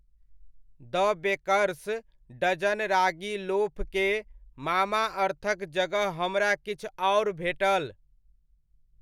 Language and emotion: Maithili, neutral